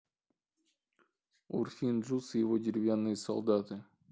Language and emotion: Russian, neutral